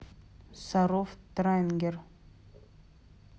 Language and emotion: Russian, neutral